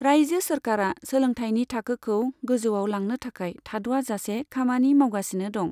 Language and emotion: Bodo, neutral